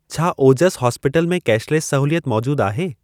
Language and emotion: Sindhi, neutral